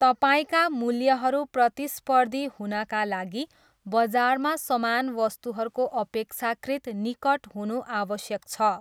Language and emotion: Nepali, neutral